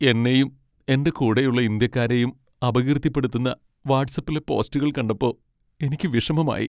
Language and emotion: Malayalam, sad